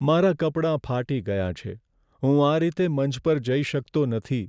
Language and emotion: Gujarati, sad